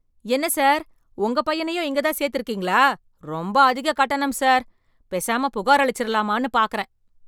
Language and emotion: Tamil, angry